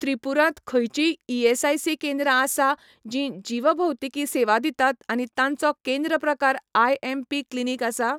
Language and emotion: Goan Konkani, neutral